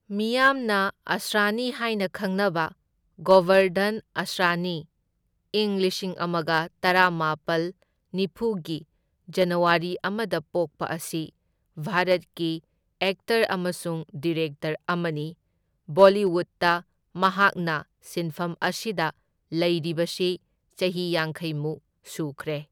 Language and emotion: Manipuri, neutral